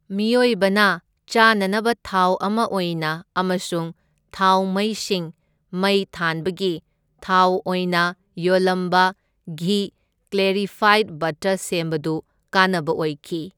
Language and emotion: Manipuri, neutral